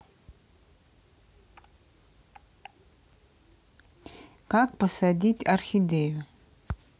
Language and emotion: Russian, neutral